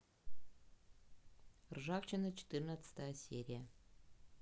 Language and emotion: Russian, neutral